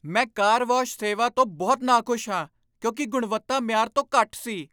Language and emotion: Punjabi, angry